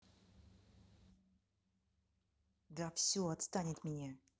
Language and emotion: Russian, angry